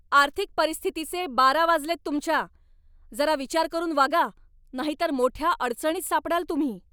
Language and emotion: Marathi, angry